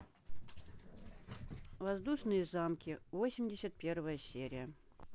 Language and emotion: Russian, neutral